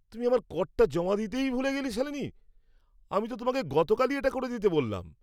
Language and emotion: Bengali, angry